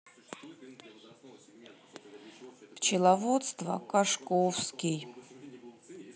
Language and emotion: Russian, sad